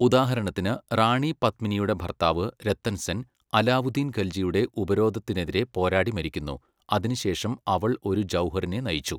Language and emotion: Malayalam, neutral